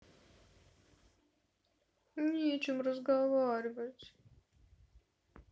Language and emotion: Russian, sad